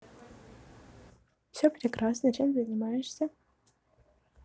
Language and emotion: Russian, positive